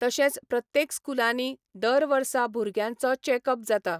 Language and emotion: Goan Konkani, neutral